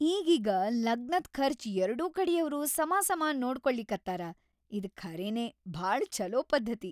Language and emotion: Kannada, happy